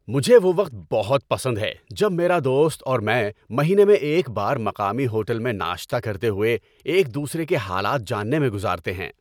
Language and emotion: Urdu, happy